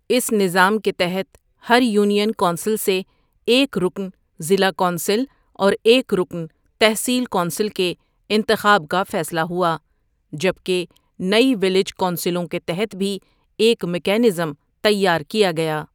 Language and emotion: Urdu, neutral